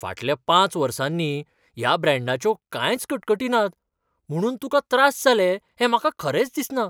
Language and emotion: Goan Konkani, surprised